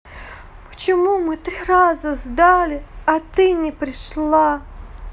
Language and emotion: Russian, sad